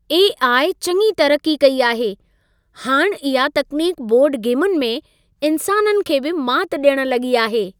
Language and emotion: Sindhi, happy